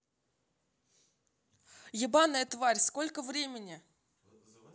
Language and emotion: Russian, angry